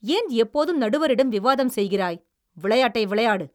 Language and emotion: Tamil, angry